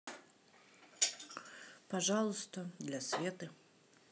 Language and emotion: Russian, neutral